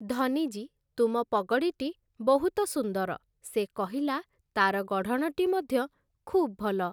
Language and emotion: Odia, neutral